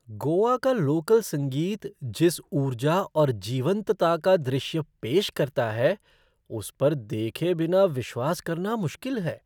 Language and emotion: Hindi, surprised